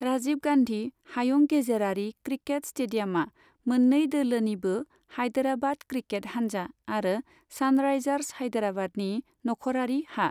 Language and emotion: Bodo, neutral